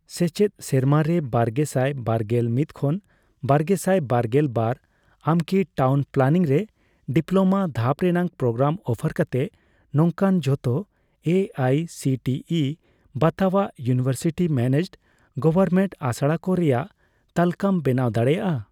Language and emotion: Santali, neutral